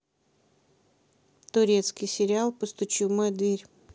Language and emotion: Russian, neutral